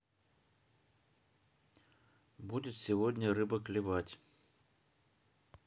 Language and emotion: Russian, neutral